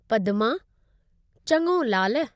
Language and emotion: Sindhi, neutral